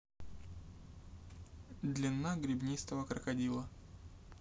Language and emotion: Russian, neutral